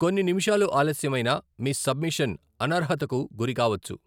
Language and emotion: Telugu, neutral